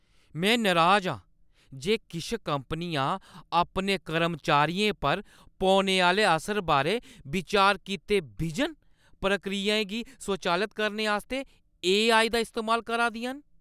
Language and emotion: Dogri, angry